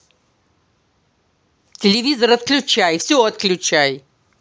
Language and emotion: Russian, angry